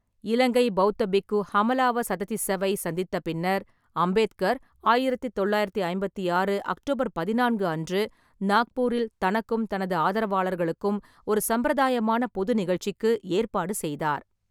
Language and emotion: Tamil, neutral